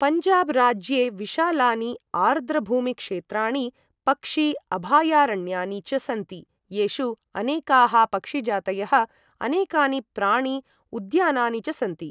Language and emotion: Sanskrit, neutral